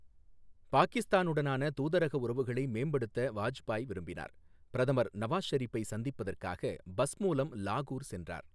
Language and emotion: Tamil, neutral